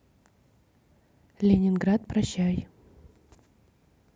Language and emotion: Russian, neutral